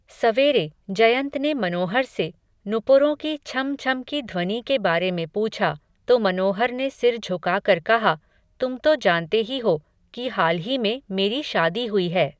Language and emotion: Hindi, neutral